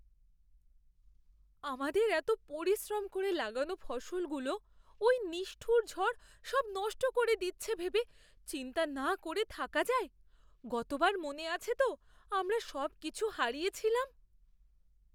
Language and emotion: Bengali, fearful